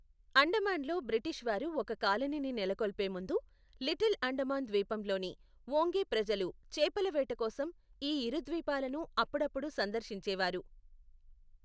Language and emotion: Telugu, neutral